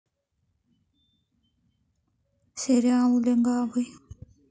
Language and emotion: Russian, neutral